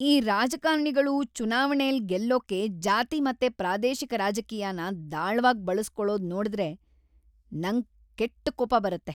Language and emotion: Kannada, angry